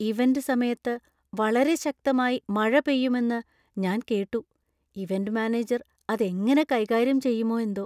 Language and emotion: Malayalam, fearful